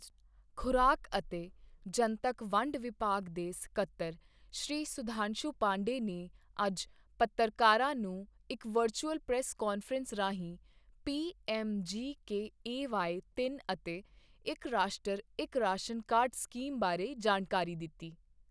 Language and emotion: Punjabi, neutral